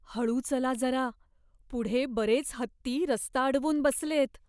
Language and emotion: Marathi, fearful